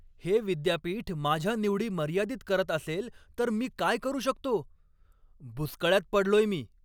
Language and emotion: Marathi, angry